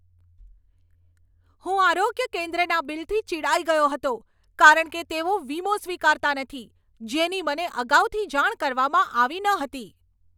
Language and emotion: Gujarati, angry